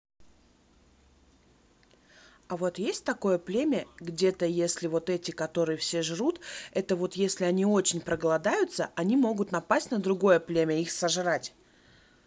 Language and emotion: Russian, neutral